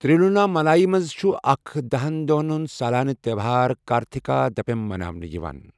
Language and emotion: Kashmiri, neutral